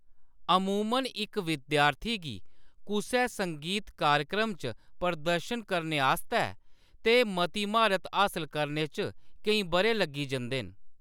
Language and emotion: Dogri, neutral